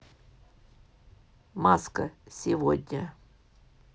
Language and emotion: Russian, neutral